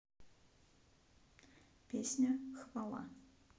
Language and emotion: Russian, neutral